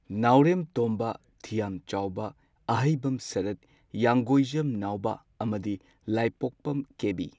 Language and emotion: Manipuri, neutral